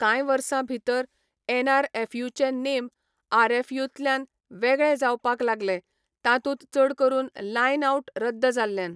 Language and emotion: Goan Konkani, neutral